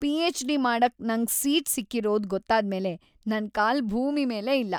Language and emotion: Kannada, happy